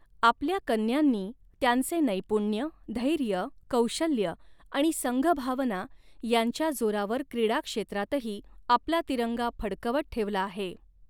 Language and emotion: Marathi, neutral